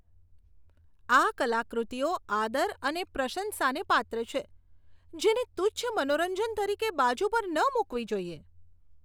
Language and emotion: Gujarati, disgusted